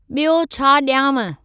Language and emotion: Sindhi, neutral